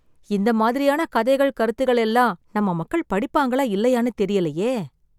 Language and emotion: Tamil, sad